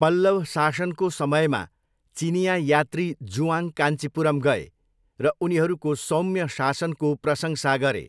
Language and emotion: Nepali, neutral